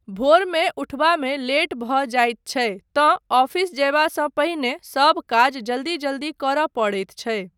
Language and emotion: Maithili, neutral